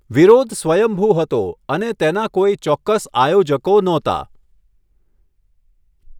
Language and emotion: Gujarati, neutral